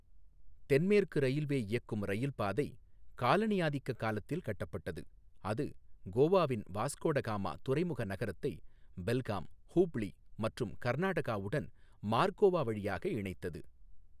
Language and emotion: Tamil, neutral